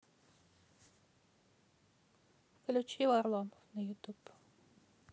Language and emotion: Russian, neutral